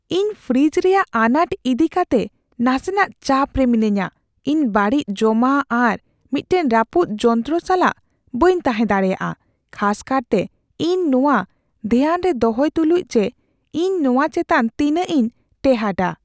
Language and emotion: Santali, fearful